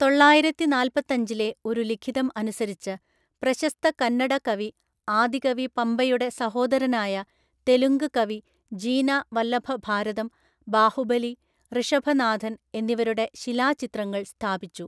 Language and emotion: Malayalam, neutral